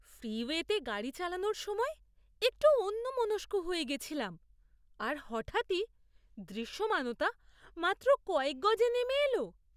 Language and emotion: Bengali, surprised